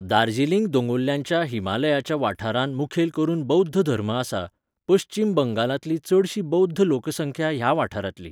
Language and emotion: Goan Konkani, neutral